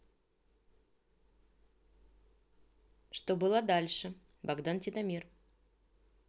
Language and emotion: Russian, neutral